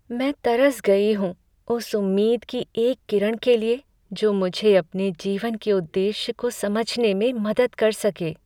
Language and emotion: Hindi, sad